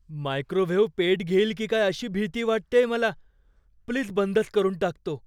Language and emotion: Marathi, fearful